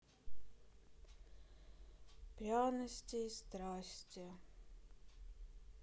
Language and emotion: Russian, sad